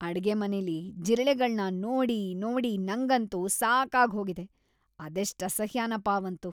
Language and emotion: Kannada, disgusted